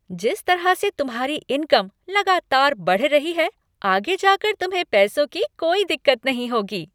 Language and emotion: Hindi, happy